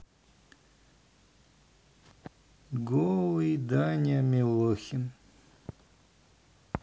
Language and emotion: Russian, neutral